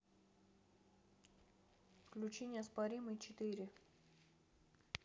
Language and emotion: Russian, neutral